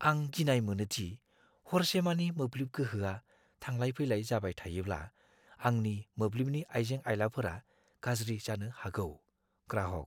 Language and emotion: Bodo, fearful